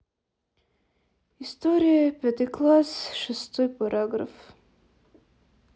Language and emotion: Russian, sad